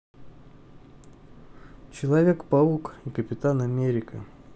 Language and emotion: Russian, neutral